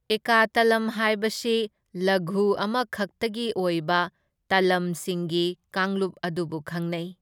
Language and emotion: Manipuri, neutral